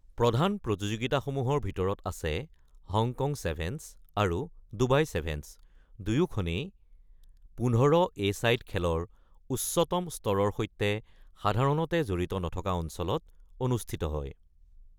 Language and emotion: Assamese, neutral